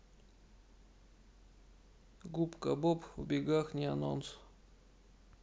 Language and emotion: Russian, neutral